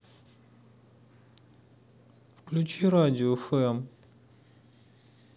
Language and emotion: Russian, sad